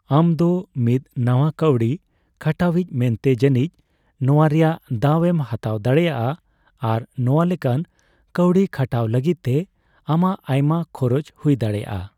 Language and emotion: Santali, neutral